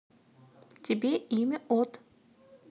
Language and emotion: Russian, neutral